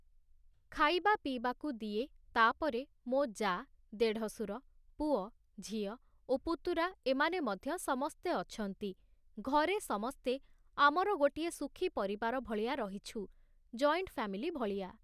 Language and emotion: Odia, neutral